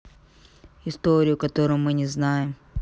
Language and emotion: Russian, neutral